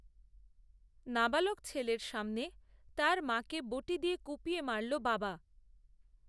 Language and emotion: Bengali, neutral